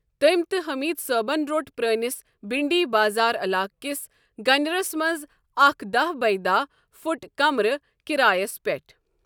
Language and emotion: Kashmiri, neutral